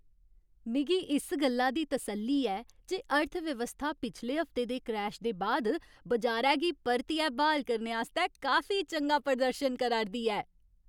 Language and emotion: Dogri, happy